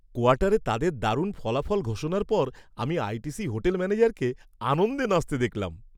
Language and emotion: Bengali, happy